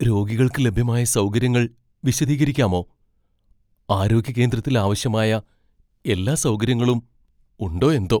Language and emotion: Malayalam, fearful